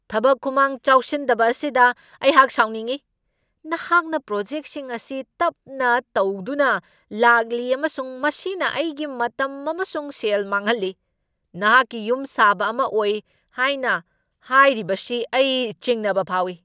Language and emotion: Manipuri, angry